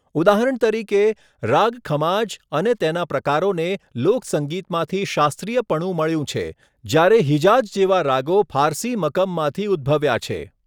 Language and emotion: Gujarati, neutral